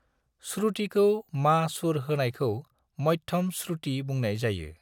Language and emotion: Bodo, neutral